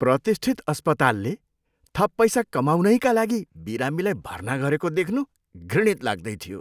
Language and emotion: Nepali, disgusted